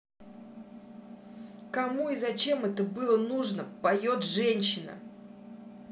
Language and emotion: Russian, angry